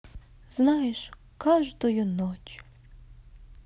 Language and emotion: Russian, sad